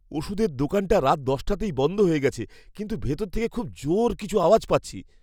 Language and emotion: Bengali, fearful